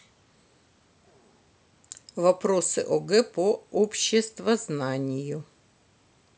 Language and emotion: Russian, neutral